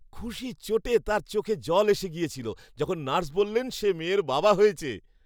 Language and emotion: Bengali, happy